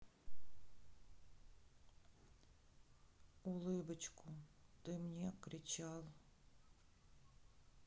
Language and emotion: Russian, sad